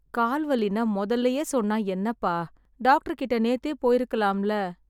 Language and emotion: Tamil, sad